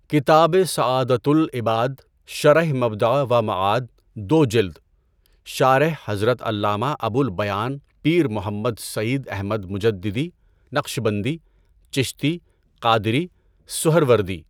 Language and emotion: Urdu, neutral